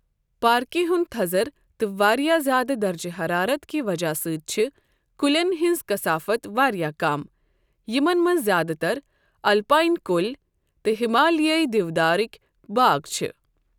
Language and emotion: Kashmiri, neutral